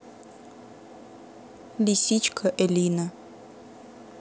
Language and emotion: Russian, neutral